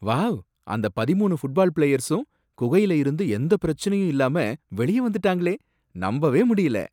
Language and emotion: Tamil, surprised